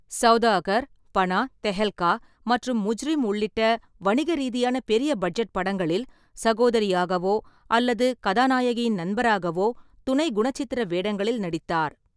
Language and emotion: Tamil, neutral